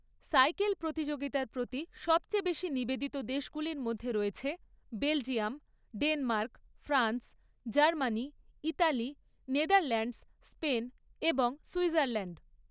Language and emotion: Bengali, neutral